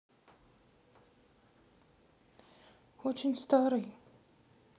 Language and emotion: Russian, sad